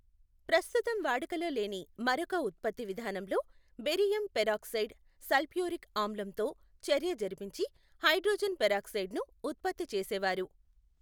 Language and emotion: Telugu, neutral